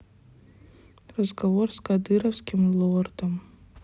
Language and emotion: Russian, sad